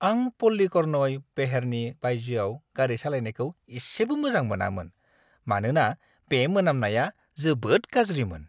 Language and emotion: Bodo, disgusted